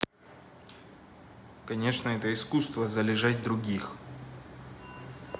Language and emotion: Russian, neutral